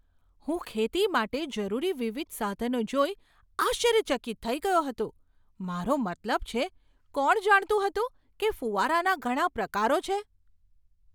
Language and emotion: Gujarati, surprised